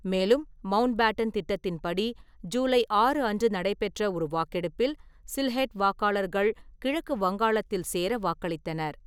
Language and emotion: Tamil, neutral